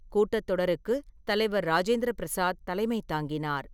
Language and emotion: Tamil, neutral